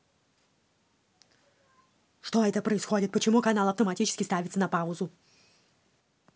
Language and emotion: Russian, angry